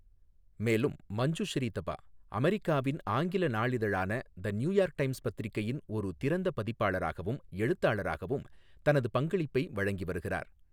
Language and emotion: Tamil, neutral